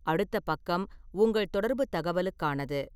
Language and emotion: Tamil, neutral